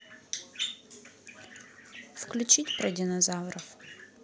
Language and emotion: Russian, neutral